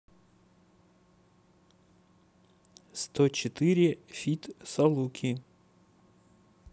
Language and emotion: Russian, neutral